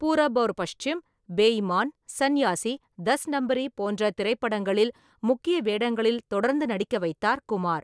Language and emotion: Tamil, neutral